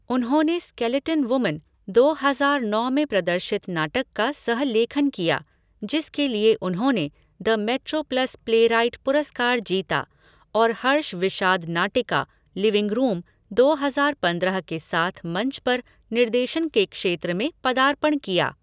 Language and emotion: Hindi, neutral